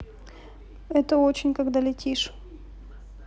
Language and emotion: Russian, neutral